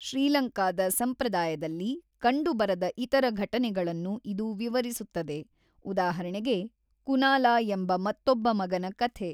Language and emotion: Kannada, neutral